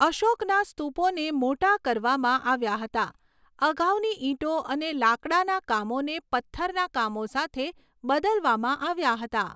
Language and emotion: Gujarati, neutral